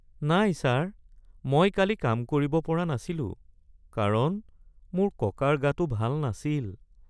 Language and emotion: Assamese, sad